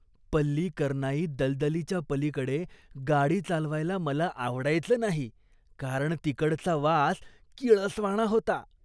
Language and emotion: Marathi, disgusted